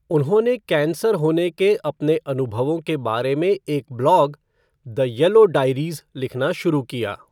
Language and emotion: Hindi, neutral